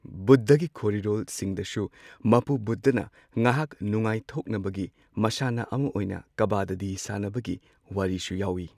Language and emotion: Manipuri, neutral